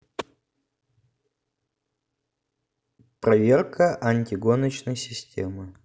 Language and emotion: Russian, neutral